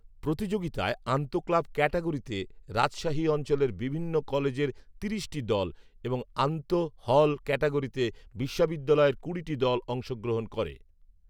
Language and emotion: Bengali, neutral